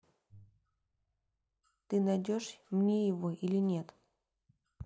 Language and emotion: Russian, neutral